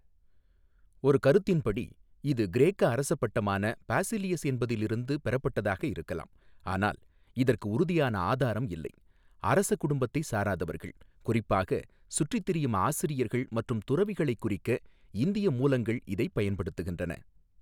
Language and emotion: Tamil, neutral